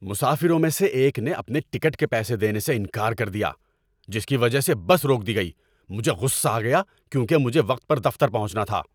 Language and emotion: Urdu, angry